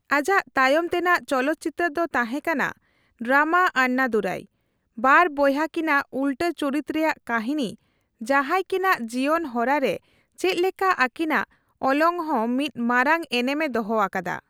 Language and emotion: Santali, neutral